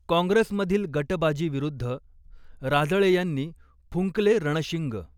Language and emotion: Marathi, neutral